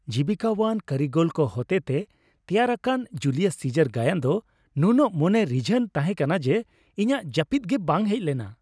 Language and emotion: Santali, happy